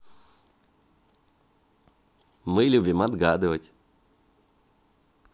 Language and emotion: Russian, positive